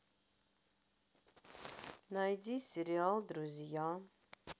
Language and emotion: Russian, neutral